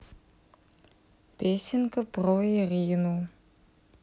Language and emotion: Russian, neutral